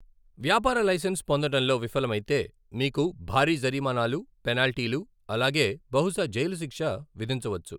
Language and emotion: Telugu, neutral